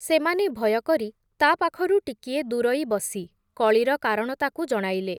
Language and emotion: Odia, neutral